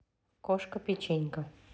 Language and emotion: Russian, neutral